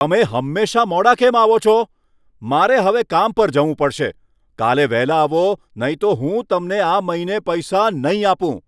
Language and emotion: Gujarati, angry